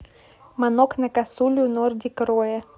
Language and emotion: Russian, neutral